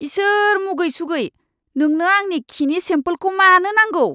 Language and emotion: Bodo, disgusted